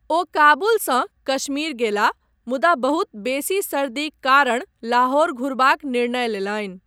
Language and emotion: Maithili, neutral